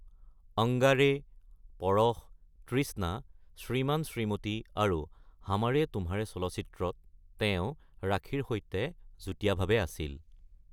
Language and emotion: Assamese, neutral